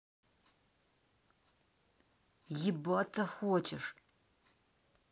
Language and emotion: Russian, angry